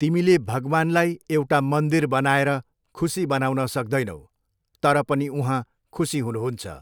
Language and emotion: Nepali, neutral